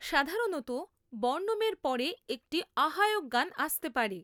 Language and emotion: Bengali, neutral